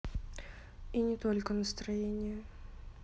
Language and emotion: Russian, sad